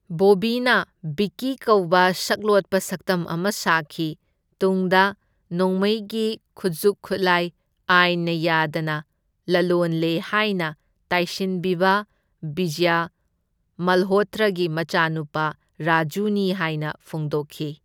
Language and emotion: Manipuri, neutral